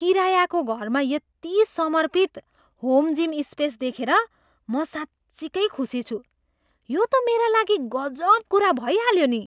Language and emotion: Nepali, surprised